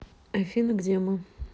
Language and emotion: Russian, neutral